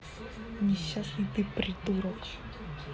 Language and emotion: Russian, angry